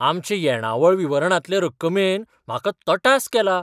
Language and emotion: Goan Konkani, surprised